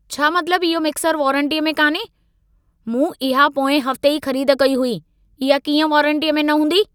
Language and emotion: Sindhi, angry